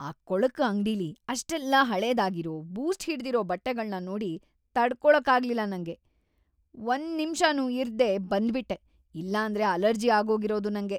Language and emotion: Kannada, disgusted